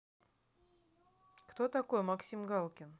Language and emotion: Russian, neutral